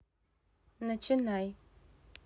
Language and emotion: Russian, neutral